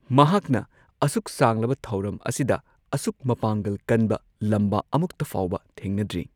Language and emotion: Manipuri, neutral